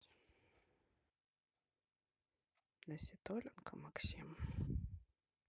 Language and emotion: Russian, sad